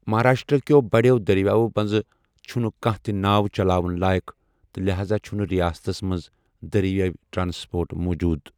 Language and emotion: Kashmiri, neutral